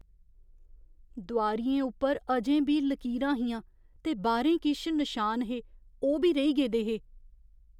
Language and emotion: Dogri, fearful